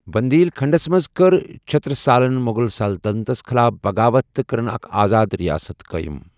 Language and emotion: Kashmiri, neutral